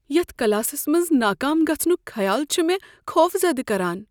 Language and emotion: Kashmiri, fearful